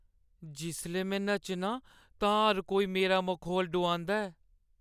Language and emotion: Dogri, sad